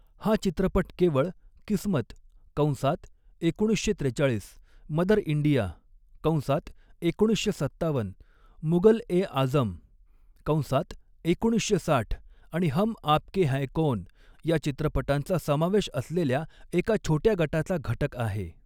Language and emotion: Marathi, neutral